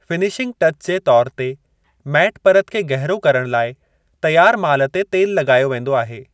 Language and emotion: Sindhi, neutral